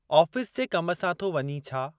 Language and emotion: Sindhi, neutral